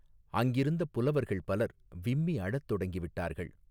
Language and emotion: Tamil, neutral